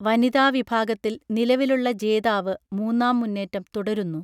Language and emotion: Malayalam, neutral